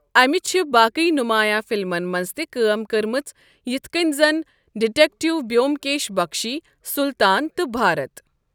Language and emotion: Kashmiri, neutral